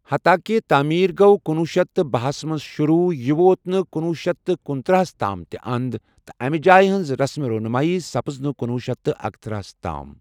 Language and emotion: Kashmiri, neutral